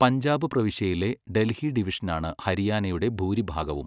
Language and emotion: Malayalam, neutral